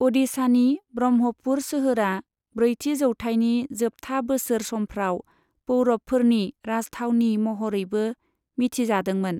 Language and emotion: Bodo, neutral